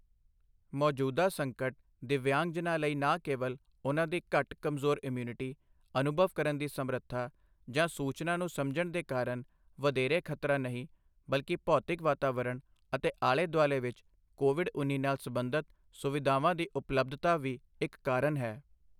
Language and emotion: Punjabi, neutral